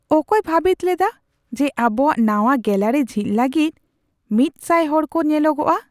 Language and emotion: Santali, surprised